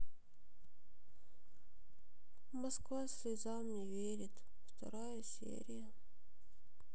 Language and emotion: Russian, sad